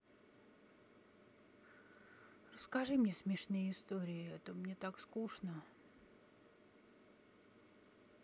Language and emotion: Russian, sad